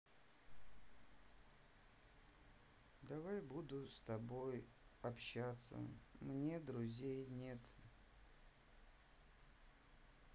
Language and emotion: Russian, sad